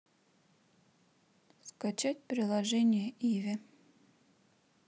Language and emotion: Russian, neutral